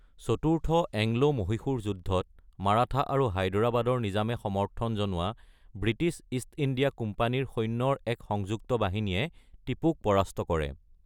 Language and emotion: Assamese, neutral